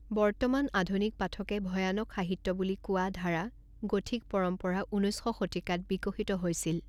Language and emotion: Assamese, neutral